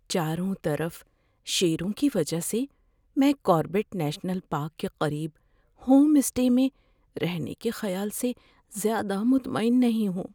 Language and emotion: Urdu, fearful